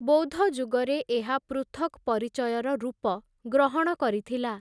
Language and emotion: Odia, neutral